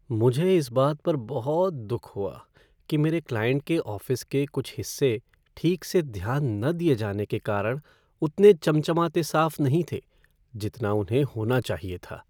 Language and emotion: Hindi, sad